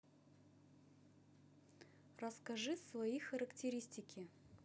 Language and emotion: Russian, neutral